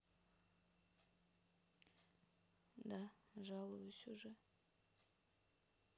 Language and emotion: Russian, sad